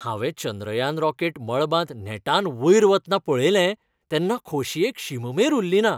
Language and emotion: Goan Konkani, happy